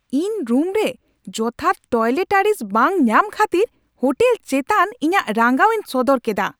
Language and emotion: Santali, angry